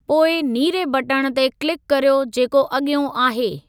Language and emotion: Sindhi, neutral